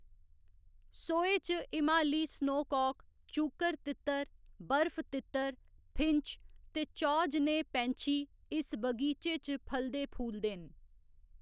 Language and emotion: Dogri, neutral